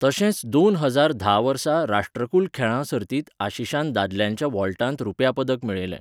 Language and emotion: Goan Konkani, neutral